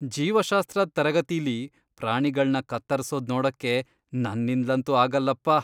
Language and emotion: Kannada, disgusted